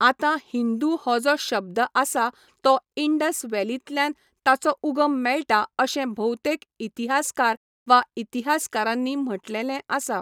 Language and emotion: Goan Konkani, neutral